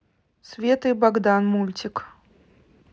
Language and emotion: Russian, neutral